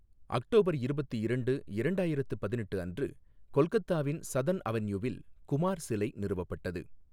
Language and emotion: Tamil, neutral